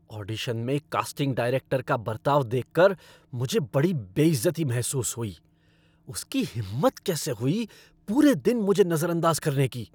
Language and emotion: Hindi, angry